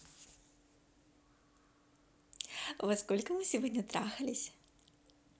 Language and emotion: Russian, positive